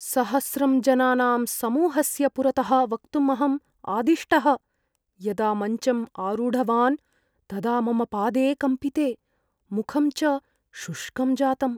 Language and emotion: Sanskrit, fearful